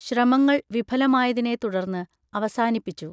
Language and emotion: Malayalam, neutral